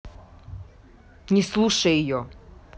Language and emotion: Russian, angry